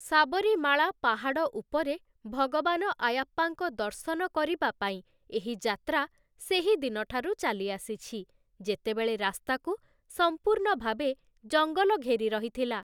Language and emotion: Odia, neutral